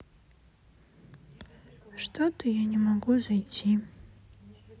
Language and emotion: Russian, sad